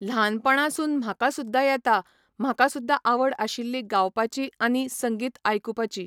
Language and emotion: Goan Konkani, neutral